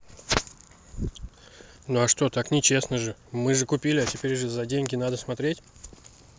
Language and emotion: Russian, neutral